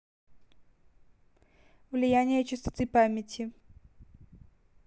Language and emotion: Russian, neutral